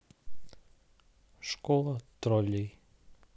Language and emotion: Russian, neutral